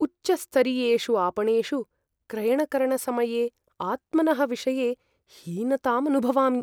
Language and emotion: Sanskrit, fearful